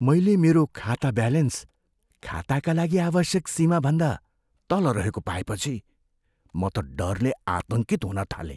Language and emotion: Nepali, fearful